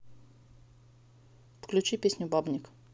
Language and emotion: Russian, neutral